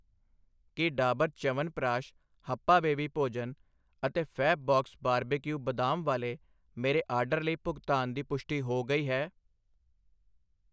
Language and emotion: Punjabi, neutral